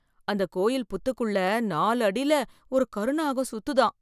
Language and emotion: Tamil, fearful